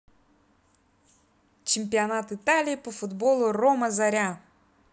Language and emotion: Russian, positive